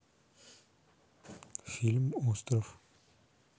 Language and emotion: Russian, neutral